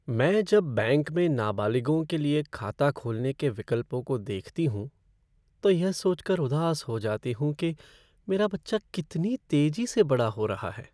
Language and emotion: Hindi, sad